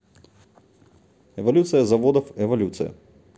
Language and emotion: Russian, neutral